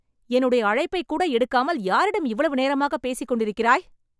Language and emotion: Tamil, angry